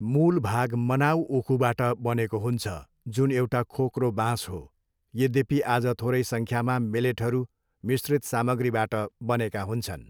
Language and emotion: Nepali, neutral